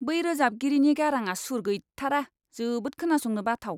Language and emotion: Bodo, disgusted